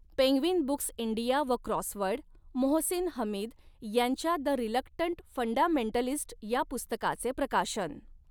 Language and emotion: Marathi, neutral